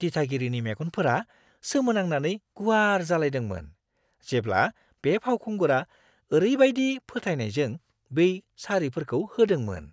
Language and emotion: Bodo, surprised